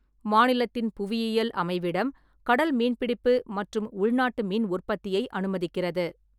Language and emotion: Tamil, neutral